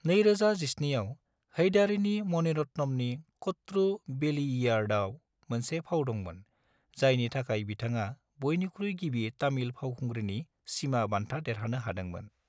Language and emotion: Bodo, neutral